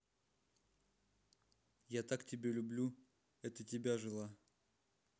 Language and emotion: Russian, neutral